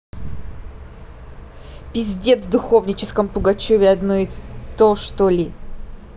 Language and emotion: Russian, angry